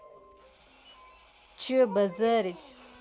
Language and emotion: Russian, angry